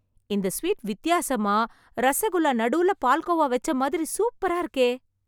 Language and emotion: Tamil, surprised